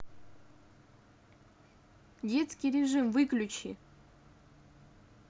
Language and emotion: Russian, angry